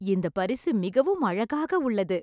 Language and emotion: Tamil, happy